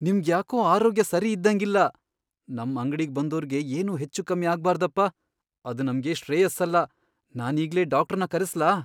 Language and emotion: Kannada, fearful